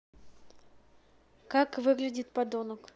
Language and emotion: Russian, neutral